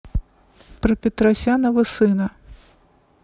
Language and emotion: Russian, neutral